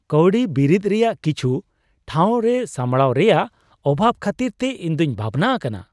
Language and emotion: Santali, surprised